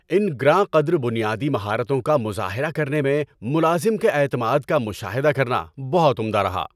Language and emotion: Urdu, happy